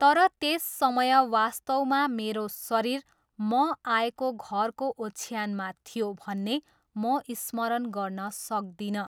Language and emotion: Nepali, neutral